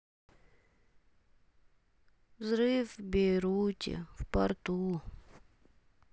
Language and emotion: Russian, sad